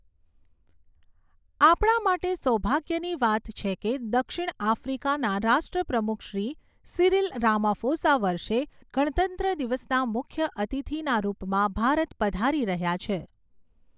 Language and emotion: Gujarati, neutral